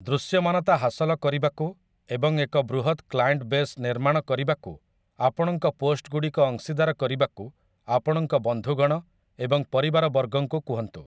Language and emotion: Odia, neutral